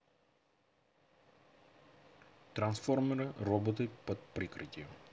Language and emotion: Russian, neutral